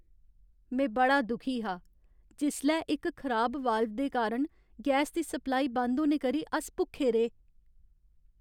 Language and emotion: Dogri, sad